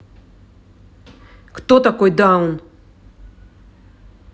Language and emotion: Russian, angry